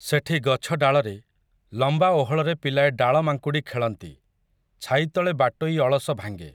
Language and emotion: Odia, neutral